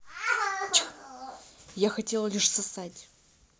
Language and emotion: Russian, neutral